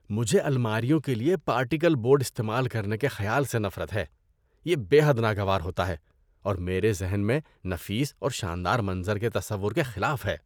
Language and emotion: Urdu, disgusted